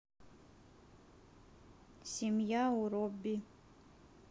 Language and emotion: Russian, neutral